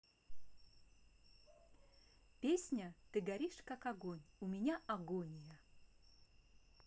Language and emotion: Russian, neutral